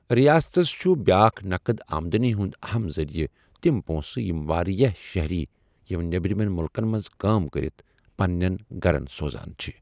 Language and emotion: Kashmiri, neutral